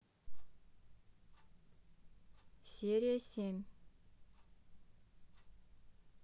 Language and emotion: Russian, neutral